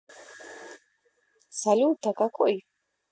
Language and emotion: Russian, neutral